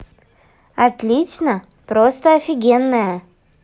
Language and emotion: Russian, positive